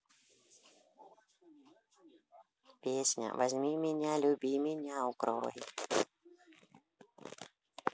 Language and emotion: Russian, neutral